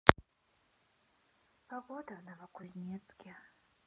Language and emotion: Russian, sad